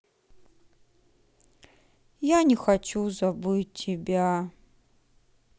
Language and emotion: Russian, sad